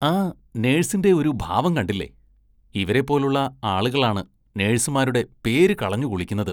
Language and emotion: Malayalam, disgusted